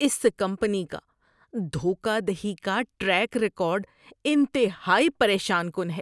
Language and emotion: Urdu, disgusted